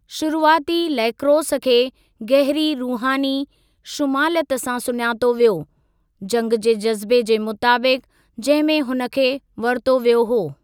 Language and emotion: Sindhi, neutral